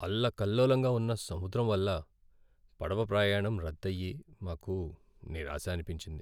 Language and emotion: Telugu, sad